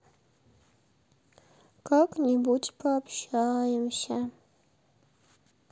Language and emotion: Russian, sad